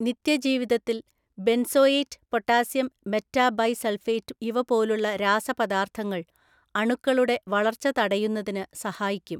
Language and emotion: Malayalam, neutral